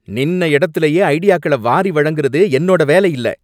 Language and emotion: Tamil, angry